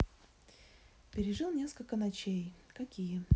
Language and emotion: Russian, neutral